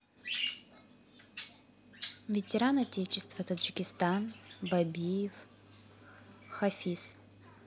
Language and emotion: Russian, neutral